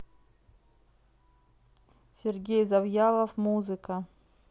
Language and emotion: Russian, neutral